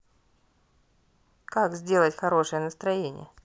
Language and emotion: Russian, neutral